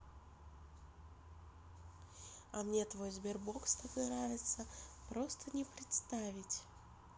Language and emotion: Russian, positive